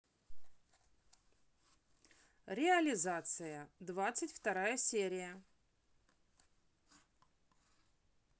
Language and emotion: Russian, positive